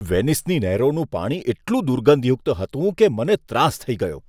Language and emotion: Gujarati, disgusted